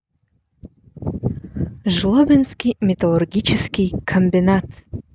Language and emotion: Russian, neutral